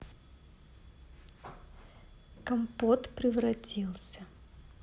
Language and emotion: Russian, neutral